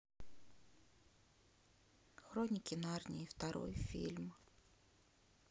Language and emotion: Russian, sad